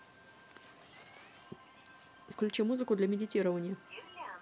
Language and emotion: Russian, neutral